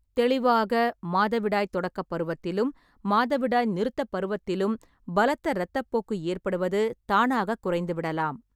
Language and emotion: Tamil, neutral